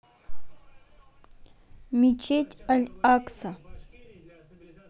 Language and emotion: Russian, neutral